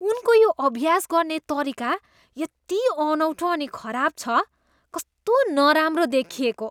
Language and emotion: Nepali, disgusted